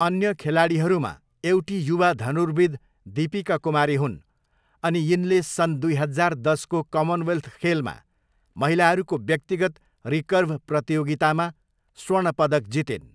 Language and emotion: Nepali, neutral